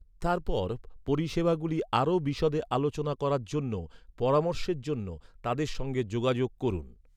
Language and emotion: Bengali, neutral